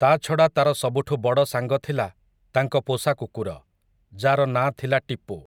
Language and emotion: Odia, neutral